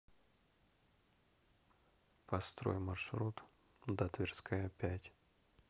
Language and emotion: Russian, neutral